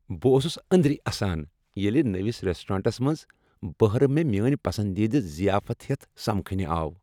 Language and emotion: Kashmiri, happy